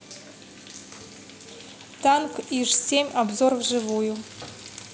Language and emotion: Russian, neutral